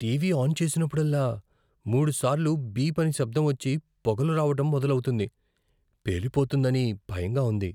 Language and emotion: Telugu, fearful